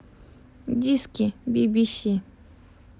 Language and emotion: Russian, neutral